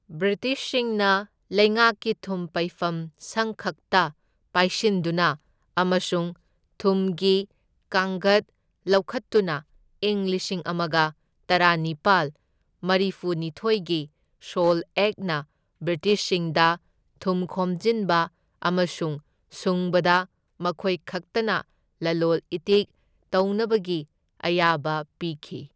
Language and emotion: Manipuri, neutral